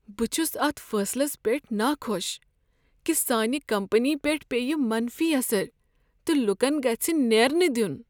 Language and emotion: Kashmiri, sad